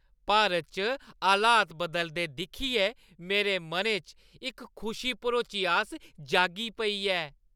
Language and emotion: Dogri, happy